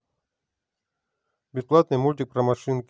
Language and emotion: Russian, neutral